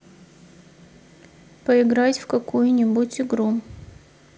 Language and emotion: Russian, sad